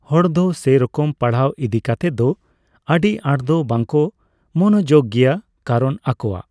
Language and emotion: Santali, neutral